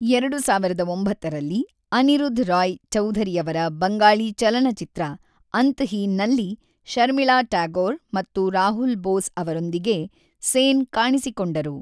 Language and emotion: Kannada, neutral